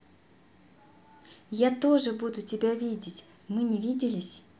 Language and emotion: Russian, positive